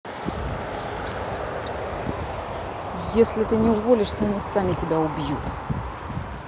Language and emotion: Russian, angry